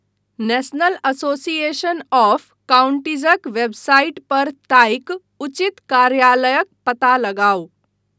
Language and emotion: Maithili, neutral